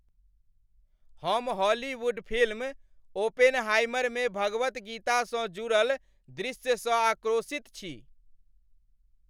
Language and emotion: Maithili, angry